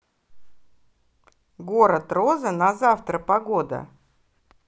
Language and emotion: Russian, positive